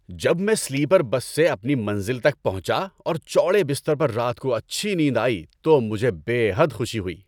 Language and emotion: Urdu, happy